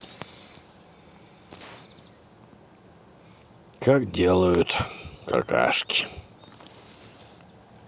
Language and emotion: Russian, neutral